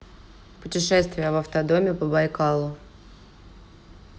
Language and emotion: Russian, neutral